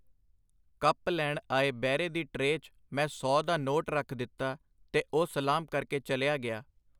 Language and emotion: Punjabi, neutral